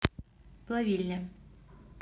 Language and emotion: Russian, neutral